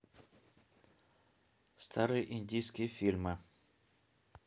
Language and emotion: Russian, neutral